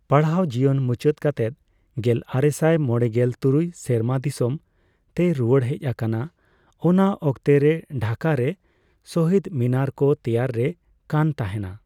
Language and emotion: Santali, neutral